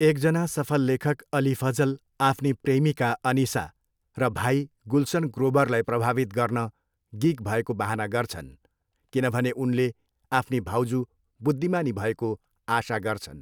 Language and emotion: Nepali, neutral